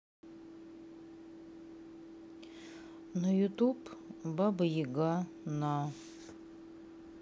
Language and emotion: Russian, sad